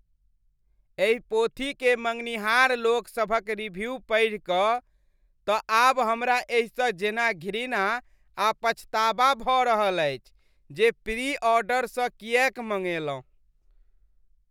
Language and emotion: Maithili, disgusted